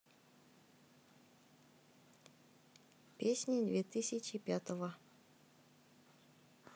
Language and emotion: Russian, neutral